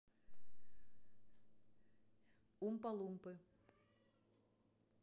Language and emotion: Russian, neutral